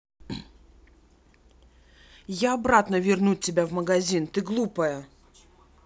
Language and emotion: Russian, angry